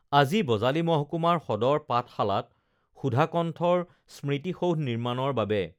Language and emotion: Assamese, neutral